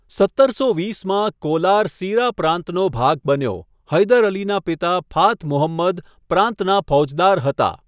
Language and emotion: Gujarati, neutral